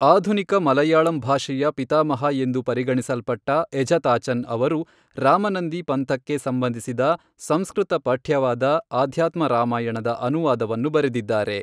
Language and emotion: Kannada, neutral